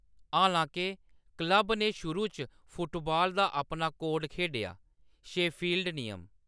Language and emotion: Dogri, neutral